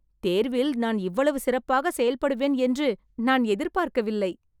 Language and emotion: Tamil, surprised